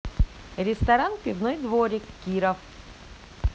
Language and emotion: Russian, positive